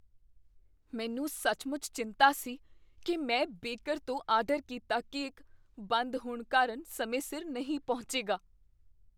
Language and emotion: Punjabi, fearful